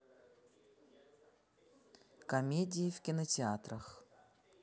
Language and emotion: Russian, neutral